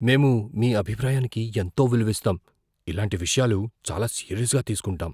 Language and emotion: Telugu, fearful